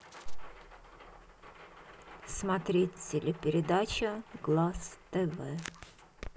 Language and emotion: Russian, neutral